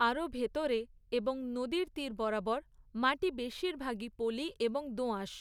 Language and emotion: Bengali, neutral